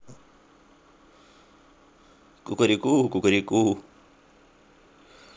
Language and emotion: Russian, neutral